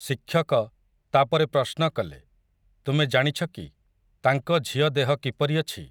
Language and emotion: Odia, neutral